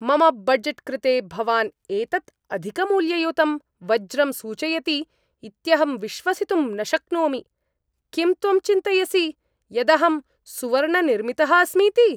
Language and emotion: Sanskrit, angry